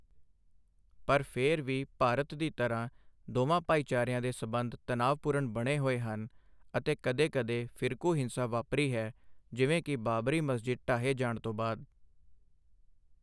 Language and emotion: Punjabi, neutral